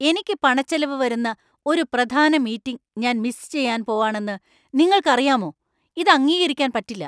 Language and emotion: Malayalam, angry